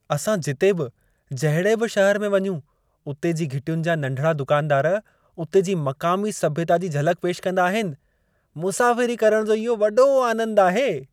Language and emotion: Sindhi, happy